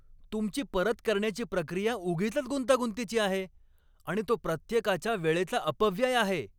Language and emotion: Marathi, angry